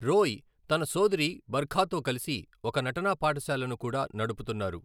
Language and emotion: Telugu, neutral